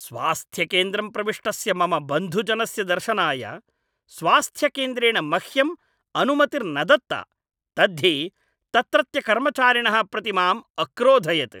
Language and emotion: Sanskrit, angry